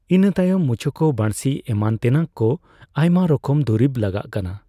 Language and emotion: Santali, neutral